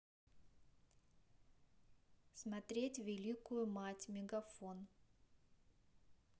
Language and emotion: Russian, neutral